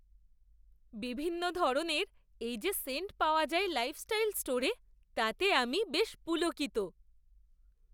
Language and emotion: Bengali, surprised